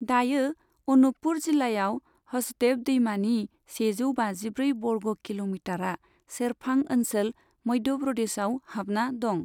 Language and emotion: Bodo, neutral